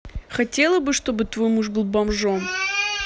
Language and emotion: Russian, neutral